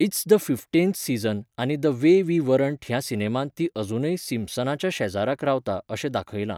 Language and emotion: Goan Konkani, neutral